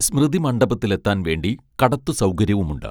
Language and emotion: Malayalam, neutral